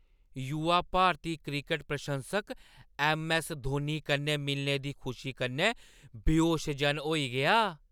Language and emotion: Dogri, happy